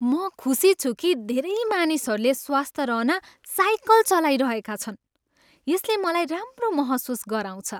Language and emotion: Nepali, happy